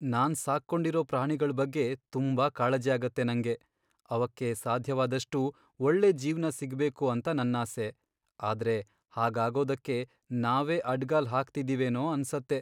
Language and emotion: Kannada, sad